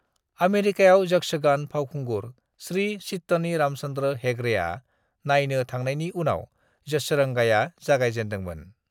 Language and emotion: Bodo, neutral